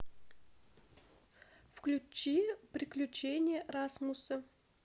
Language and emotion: Russian, neutral